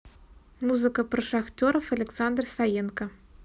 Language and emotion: Russian, neutral